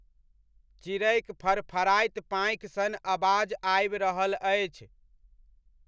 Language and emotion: Maithili, neutral